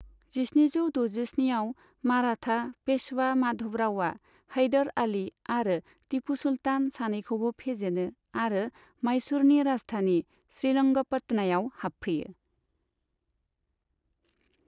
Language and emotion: Bodo, neutral